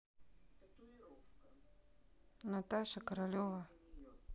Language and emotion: Russian, neutral